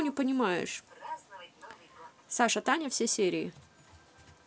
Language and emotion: Russian, angry